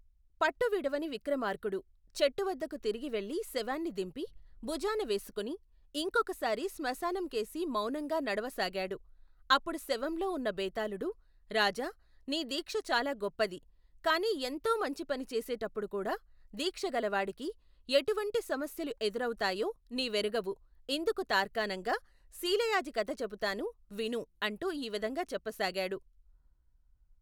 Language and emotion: Telugu, neutral